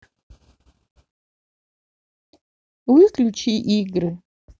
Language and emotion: Russian, neutral